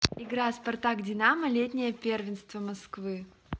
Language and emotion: Russian, positive